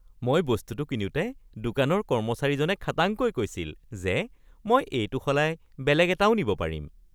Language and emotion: Assamese, happy